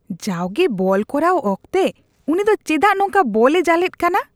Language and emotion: Santali, disgusted